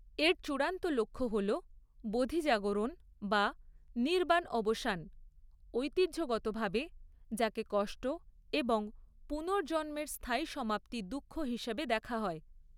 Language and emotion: Bengali, neutral